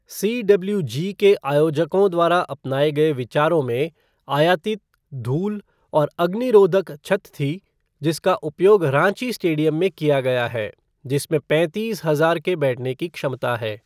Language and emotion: Hindi, neutral